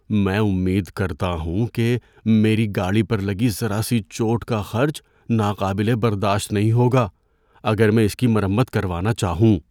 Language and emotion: Urdu, fearful